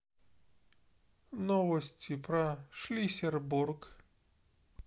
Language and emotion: Russian, neutral